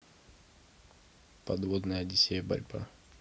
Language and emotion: Russian, neutral